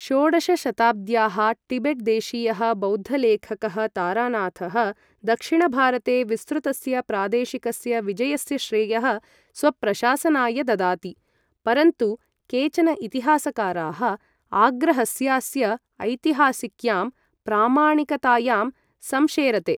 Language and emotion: Sanskrit, neutral